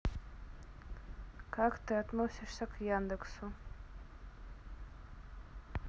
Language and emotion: Russian, neutral